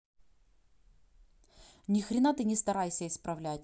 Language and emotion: Russian, angry